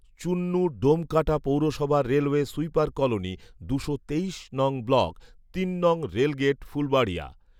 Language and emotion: Bengali, neutral